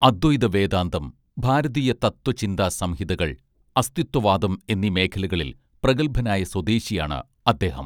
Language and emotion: Malayalam, neutral